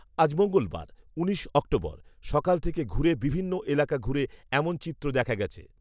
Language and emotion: Bengali, neutral